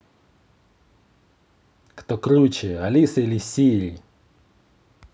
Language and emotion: Russian, positive